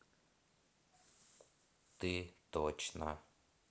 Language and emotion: Russian, neutral